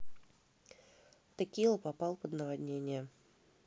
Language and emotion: Russian, neutral